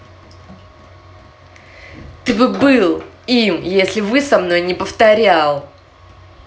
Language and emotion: Russian, angry